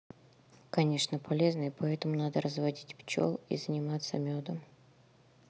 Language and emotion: Russian, neutral